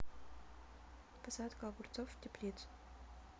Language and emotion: Russian, neutral